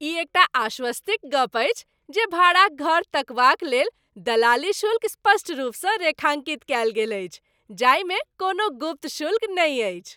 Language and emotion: Maithili, happy